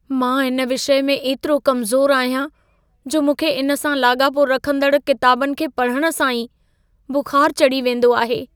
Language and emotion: Sindhi, fearful